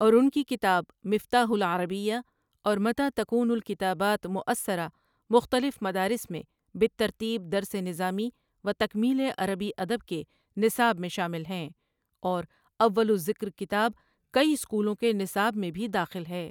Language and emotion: Urdu, neutral